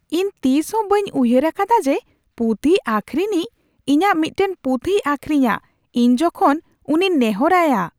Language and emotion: Santali, surprised